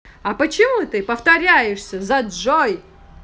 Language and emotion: Russian, angry